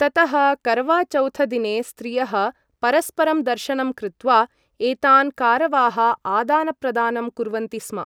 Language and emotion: Sanskrit, neutral